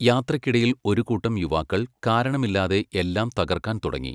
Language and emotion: Malayalam, neutral